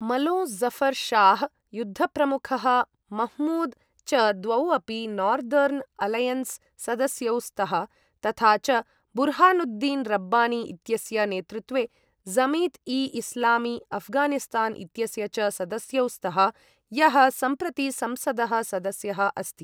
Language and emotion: Sanskrit, neutral